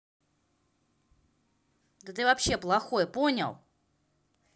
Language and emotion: Russian, angry